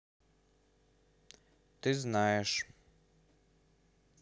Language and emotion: Russian, neutral